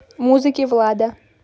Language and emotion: Russian, neutral